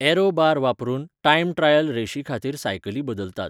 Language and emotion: Goan Konkani, neutral